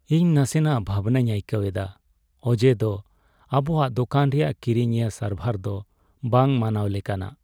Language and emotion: Santali, sad